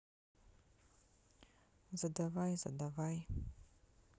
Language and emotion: Russian, neutral